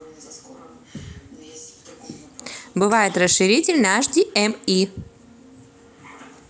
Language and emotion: Russian, positive